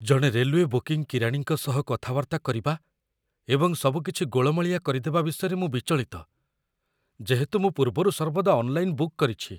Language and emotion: Odia, fearful